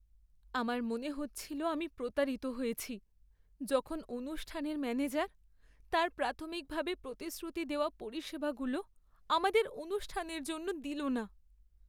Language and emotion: Bengali, sad